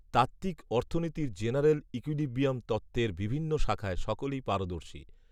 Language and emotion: Bengali, neutral